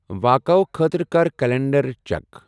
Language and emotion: Kashmiri, neutral